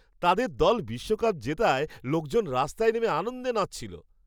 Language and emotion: Bengali, happy